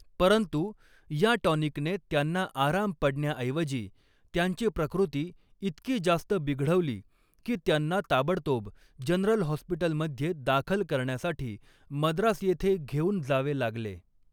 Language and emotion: Marathi, neutral